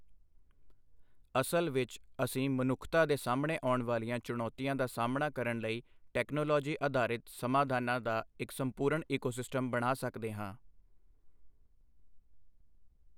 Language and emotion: Punjabi, neutral